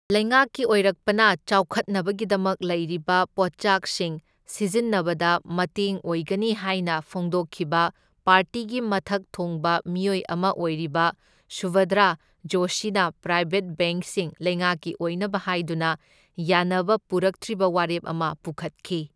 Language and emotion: Manipuri, neutral